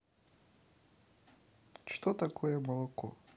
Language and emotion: Russian, neutral